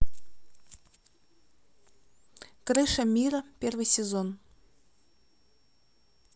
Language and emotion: Russian, neutral